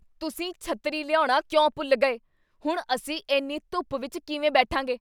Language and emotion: Punjabi, angry